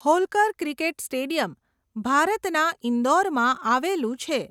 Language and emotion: Gujarati, neutral